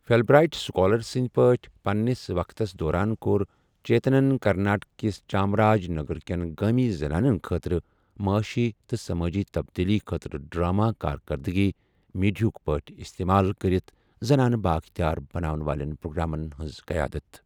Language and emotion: Kashmiri, neutral